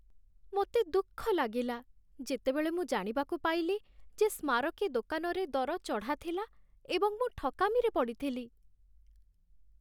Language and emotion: Odia, sad